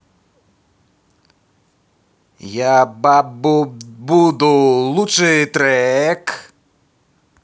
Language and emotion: Russian, positive